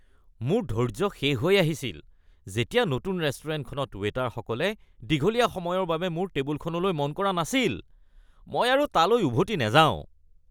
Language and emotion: Assamese, disgusted